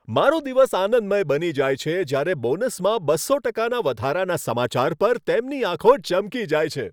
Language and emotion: Gujarati, happy